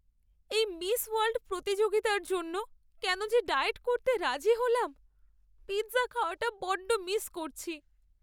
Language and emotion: Bengali, sad